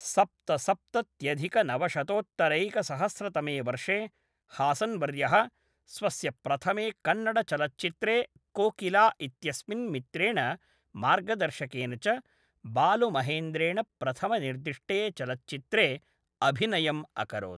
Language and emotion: Sanskrit, neutral